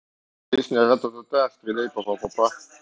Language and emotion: Russian, neutral